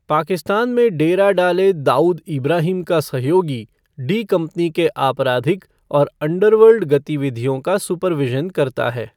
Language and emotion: Hindi, neutral